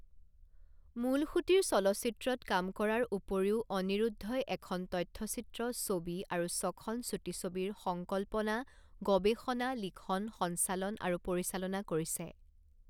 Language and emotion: Assamese, neutral